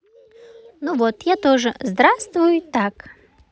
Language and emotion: Russian, positive